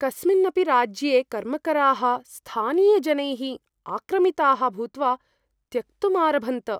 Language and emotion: Sanskrit, fearful